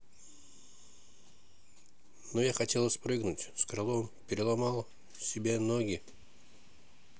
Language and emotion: Russian, neutral